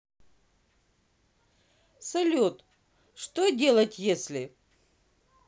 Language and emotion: Russian, positive